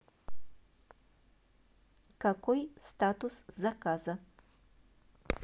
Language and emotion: Russian, neutral